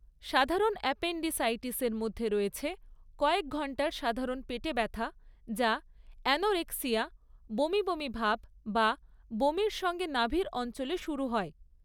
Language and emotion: Bengali, neutral